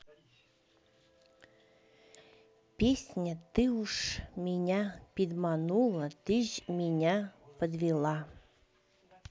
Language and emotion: Russian, neutral